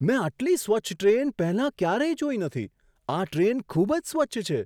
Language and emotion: Gujarati, surprised